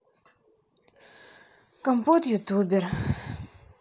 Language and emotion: Russian, neutral